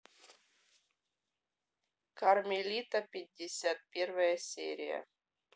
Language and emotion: Russian, neutral